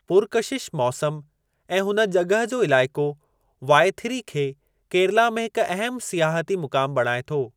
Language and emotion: Sindhi, neutral